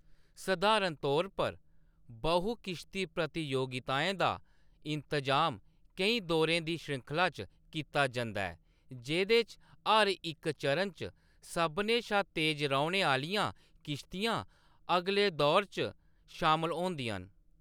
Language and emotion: Dogri, neutral